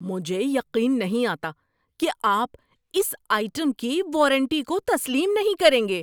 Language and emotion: Urdu, angry